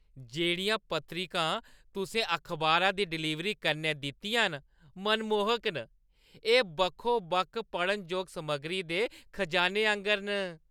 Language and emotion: Dogri, happy